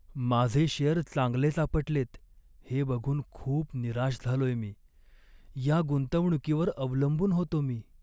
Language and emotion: Marathi, sad